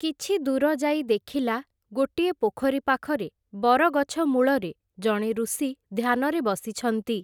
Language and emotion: Odia, neutral